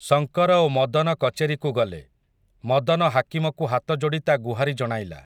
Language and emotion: Odia, neutral